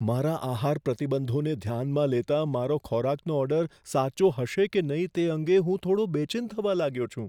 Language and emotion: Gujarati, fearful